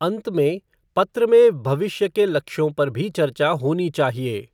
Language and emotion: Hindi, neutral